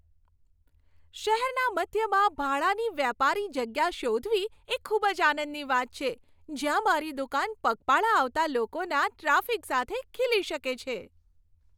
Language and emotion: Gujarati, happy